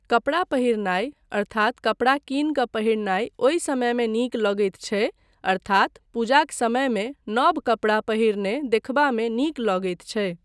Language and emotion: Maithili, neutral